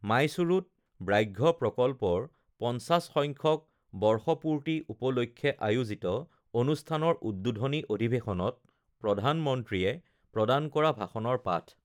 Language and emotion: Assamese, neutral